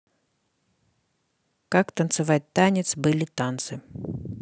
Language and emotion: Russian, neutral